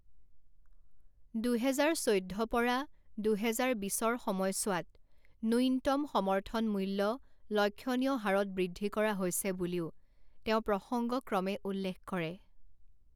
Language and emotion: Assamese, neutral